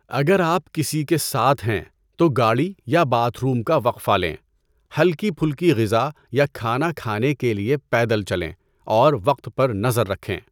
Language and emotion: Urdu, neutral